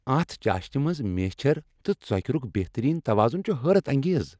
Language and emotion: Kashmiri, happy